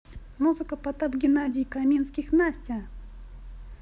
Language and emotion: Russian, positive